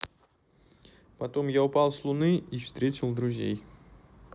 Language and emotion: Russian, neutral